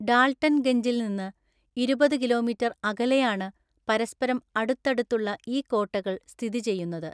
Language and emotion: Malayalam, neutral